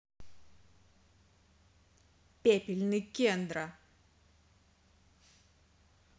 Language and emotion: Russian, angry